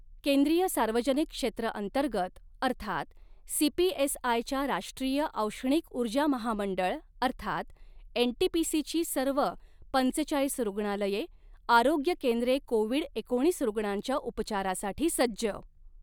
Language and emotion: Marathi, neutral